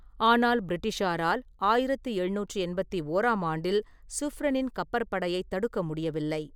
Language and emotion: Tamil, neutral